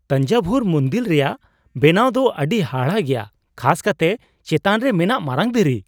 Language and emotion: Santali, surprised